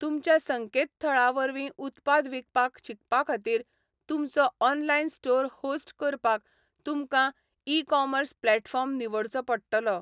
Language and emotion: Goan Konkani, neutral